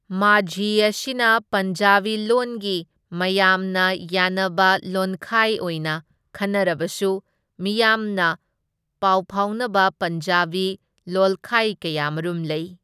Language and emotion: Manipuri, neutral